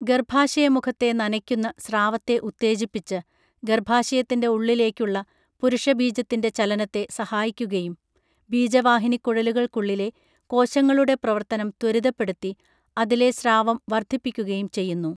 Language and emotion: Malayalam, neutral